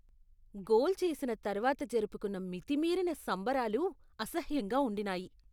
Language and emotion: Telugu, disgusted